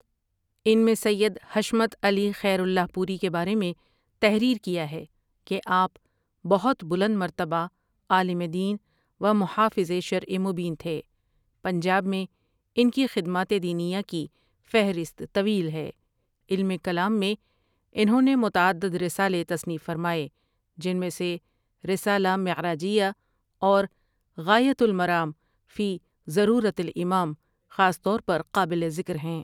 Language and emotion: Urdu, neutral